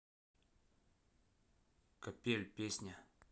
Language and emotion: Russian, neutral